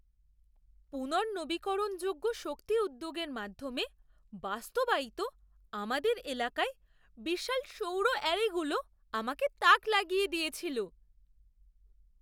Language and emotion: Bengali, surprised